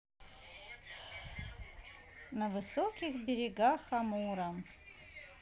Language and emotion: Russian, neutral